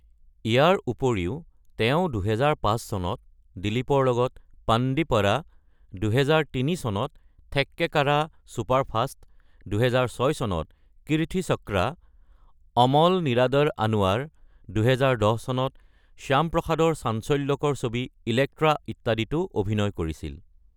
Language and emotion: Assamese, neutral